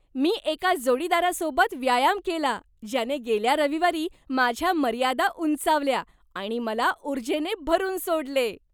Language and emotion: Marathi, happy